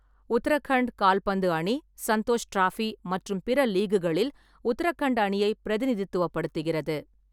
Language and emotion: Tamil, neutral